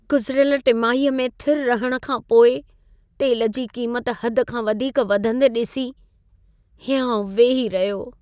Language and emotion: Sindhi, sad